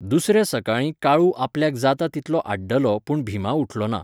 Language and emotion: Goan Konkani, neutral